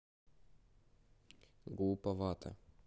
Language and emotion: Russian, neutral